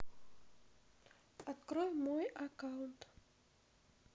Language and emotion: Russian, neutral